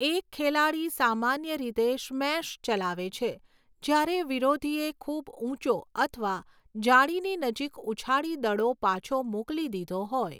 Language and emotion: Gujarati, neutral